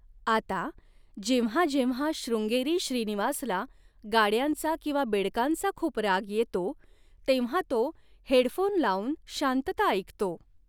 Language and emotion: Marathi, neutral